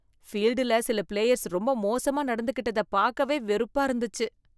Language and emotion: Tamil, disgusted